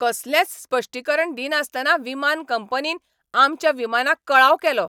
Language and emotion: Goan Konkani, angry